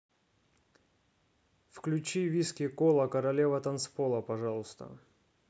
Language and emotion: Russian, neutral